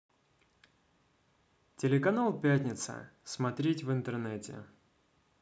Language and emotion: Russian, positive